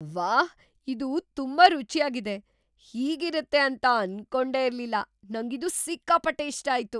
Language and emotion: Kannada, surprised